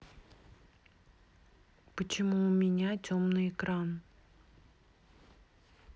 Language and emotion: Russian, neutral